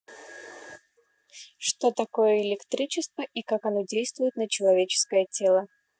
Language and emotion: Russian, neutral